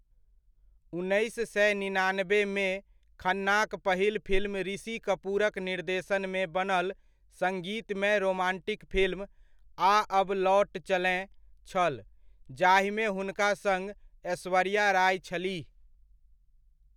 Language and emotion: Maithili, neutral